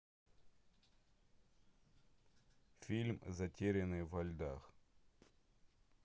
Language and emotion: Russian, neutral